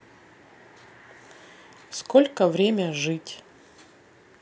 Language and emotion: Russian, neutral